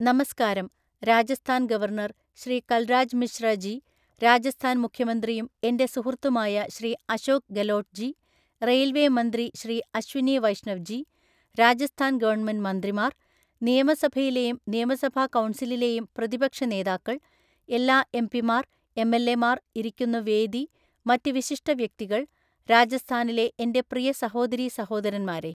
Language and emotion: Malayalam, neutral